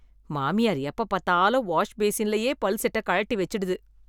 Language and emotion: Tamil, disgusted